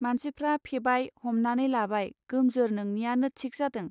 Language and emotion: Bodo, neutral